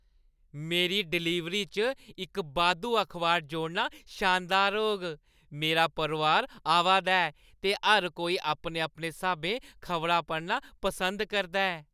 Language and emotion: Dogri, happy